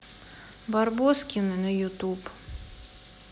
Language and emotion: Russian, neutral